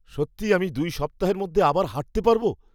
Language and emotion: Bengali, surprised